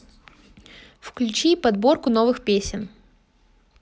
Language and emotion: Russian, positive